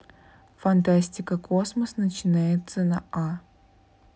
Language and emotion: Russian, neutral